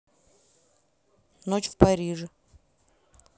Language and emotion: Russian, neutral